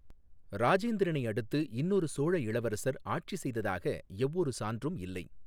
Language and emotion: Tamil, neutral